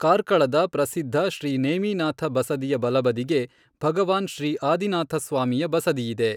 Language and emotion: Kannada, neutral